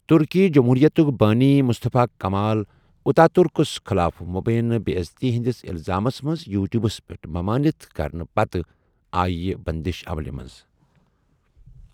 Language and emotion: Kashmiri, neutral